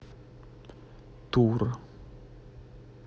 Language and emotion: Russian, neutral